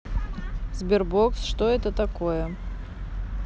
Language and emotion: Russian, neutral